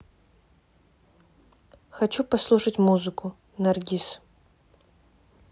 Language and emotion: Russian, neutral